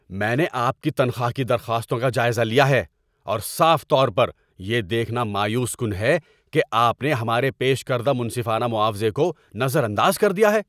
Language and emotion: Urdu, angry